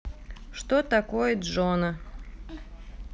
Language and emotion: Russian, neutral